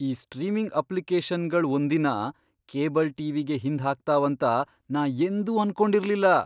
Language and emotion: Kannada, surprised